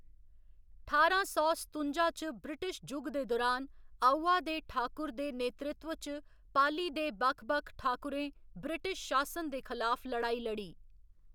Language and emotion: Dogri, neutral